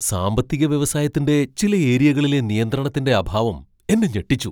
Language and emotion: Malayalam, surprised